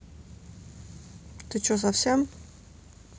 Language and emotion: Russian, angry